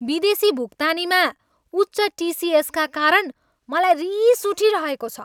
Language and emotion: Nepali, angry